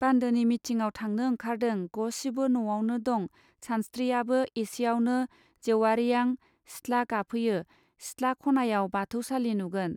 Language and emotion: Bodo, neutral